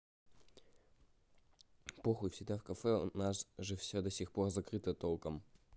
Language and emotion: Russian, neutral